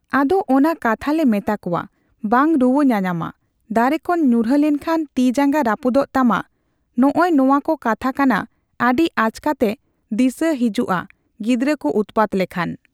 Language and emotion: Santali, neutral